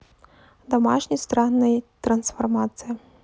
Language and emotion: Russian, neutral